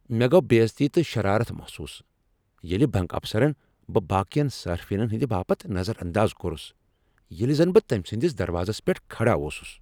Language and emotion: Kashmiri, angry